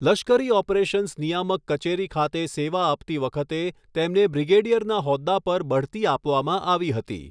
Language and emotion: Gujarati, neutral